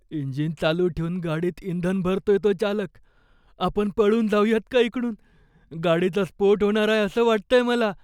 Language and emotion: Marathi, fearful